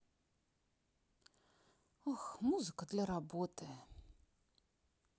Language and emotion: Russian, neutral